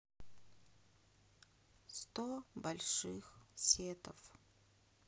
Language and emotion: Russian, sad